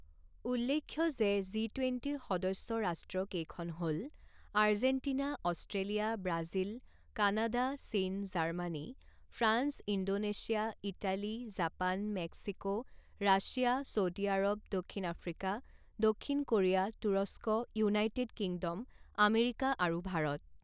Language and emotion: Assamese, neutral